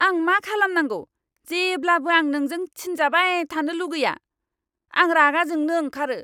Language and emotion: Bodo, angry